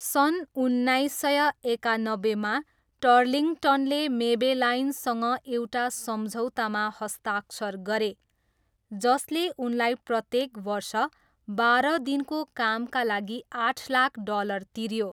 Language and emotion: Nepali, neutral